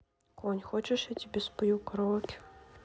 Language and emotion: Russian, neutral